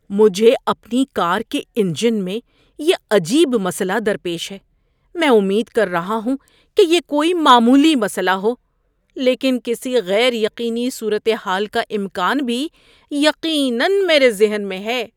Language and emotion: Urdu, fearful